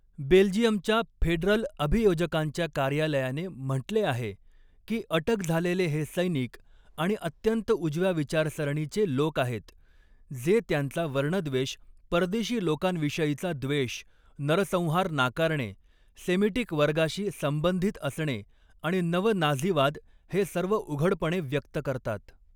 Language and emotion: Marathi, neutral